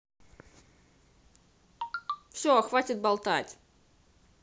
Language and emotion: Russian, angry